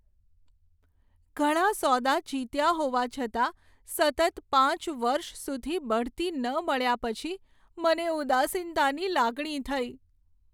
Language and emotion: Gujarati, sad